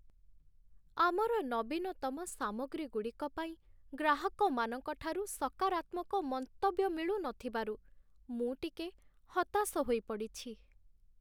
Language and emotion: Odia, sad